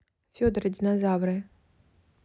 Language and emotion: Russian, neutral